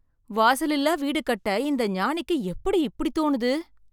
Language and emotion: Tamil, surprised